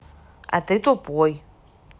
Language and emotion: Russian, neutral